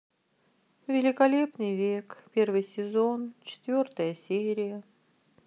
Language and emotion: Russian, sad